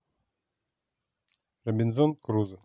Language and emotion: Russian, neutral